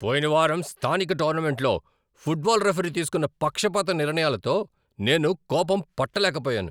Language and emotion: Telugu, angry